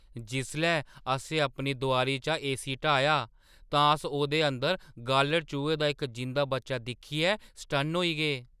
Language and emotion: Dogri, surprised